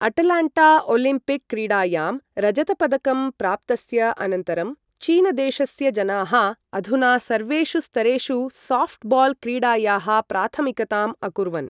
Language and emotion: Sanskrit, neutral